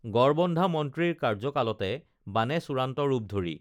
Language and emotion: Assamese, neutral